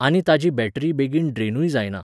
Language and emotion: Goan Konkani, neutral